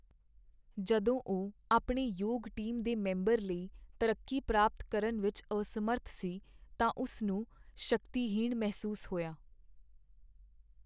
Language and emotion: Punjabi, sad